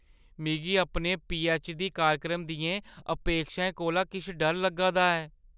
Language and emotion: Dogri, fearful